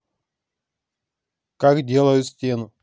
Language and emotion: Russian, neutral